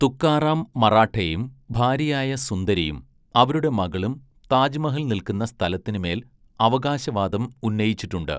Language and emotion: Malayalam, neutral